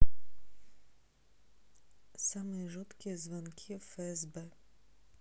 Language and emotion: Russian, neutral